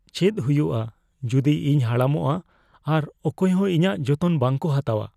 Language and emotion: Santali, fearful